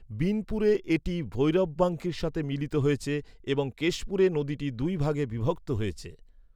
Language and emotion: Bengali, neutral